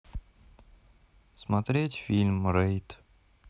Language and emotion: Russian, sad